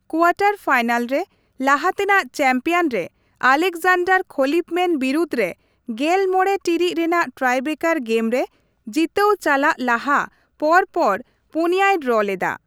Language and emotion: Santali, neutral